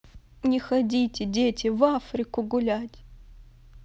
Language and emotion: Russian, sad